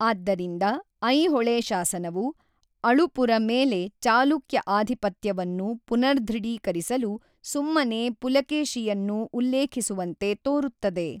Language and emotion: Kannada, neutral